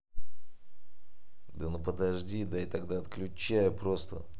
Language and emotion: Russian, angry